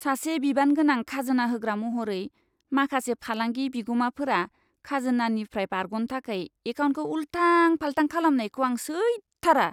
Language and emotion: Bodo, disgusted